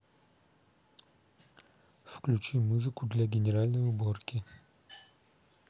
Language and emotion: Russian, neutral